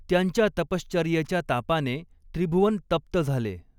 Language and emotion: Marathi, neutral